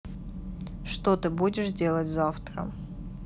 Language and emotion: Russian, neutral